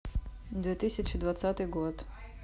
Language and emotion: Russian, neutral